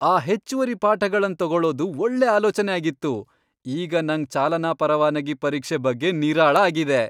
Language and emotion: Kannada, happy